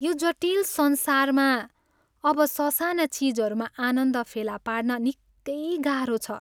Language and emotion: Nepali, sad